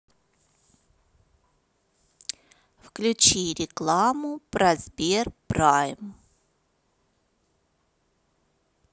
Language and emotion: Russian, neutral